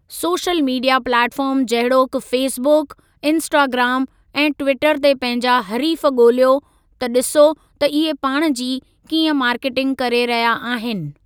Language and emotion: Sindhi, neutral